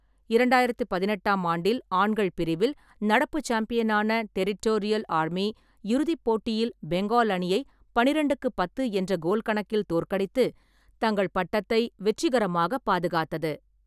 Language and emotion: Tamil, neutral